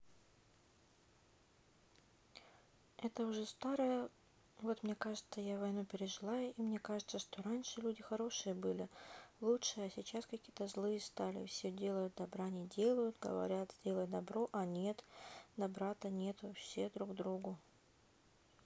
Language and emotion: Russian, sad